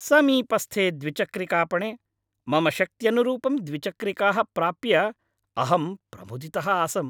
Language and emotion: Sanskrit, happy